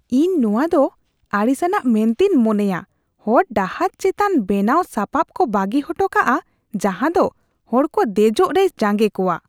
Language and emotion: Santali, disgusted